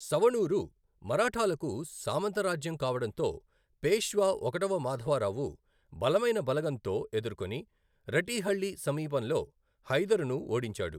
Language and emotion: Telugu, neutral